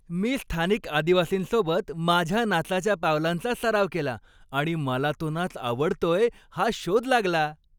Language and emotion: Marathi, happy